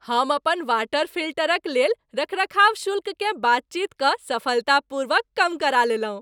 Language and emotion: Maithili, happy